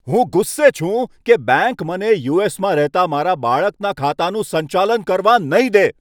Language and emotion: Gujarati, angry